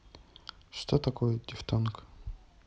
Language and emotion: Russian, neutral